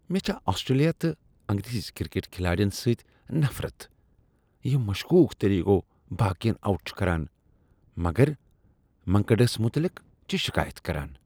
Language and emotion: Kashmiri, disgusted